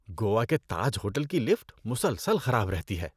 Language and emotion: Urdu, disgusted